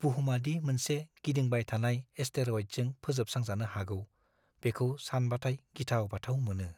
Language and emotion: Bodo, fearful